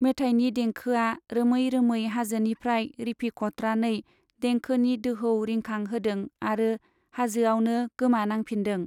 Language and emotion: Bodo, neutral